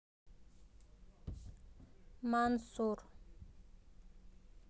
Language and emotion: Russian, neutral